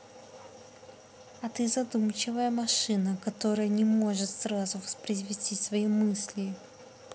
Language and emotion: Russian, neutral